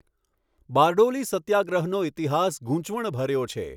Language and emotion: Gujarati, neutral